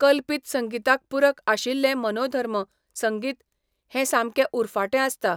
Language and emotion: Goan Konkani, neutral